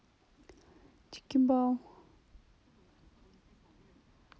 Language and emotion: Russian, neutral